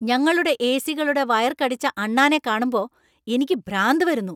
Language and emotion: Malayalam, angry